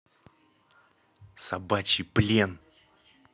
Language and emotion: Russian, angry